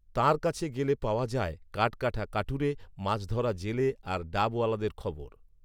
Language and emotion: Bengali, neutral